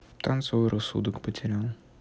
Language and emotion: Russian, sad